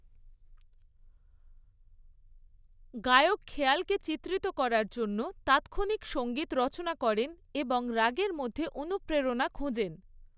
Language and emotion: Bengali, neutral